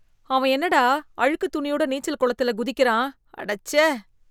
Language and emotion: Tamil, disgusted